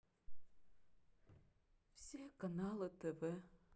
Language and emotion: Russian, sad